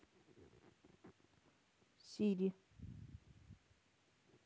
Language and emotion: Russian, neutral